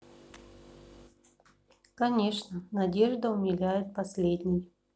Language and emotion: Russian, sad